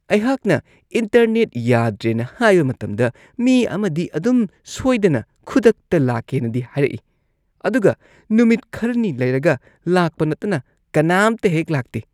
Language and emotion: Manipuri, disgusted